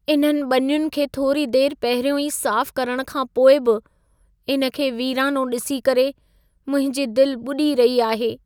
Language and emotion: Sindhi, sad